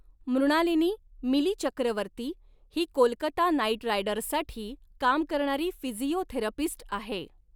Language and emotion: Marathi, neutral